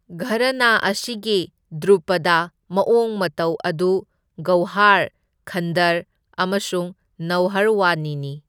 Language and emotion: Manipuri, neutral